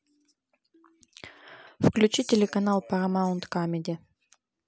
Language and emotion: Russian, neutral